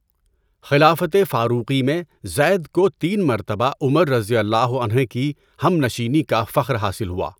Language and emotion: Urdu, neutral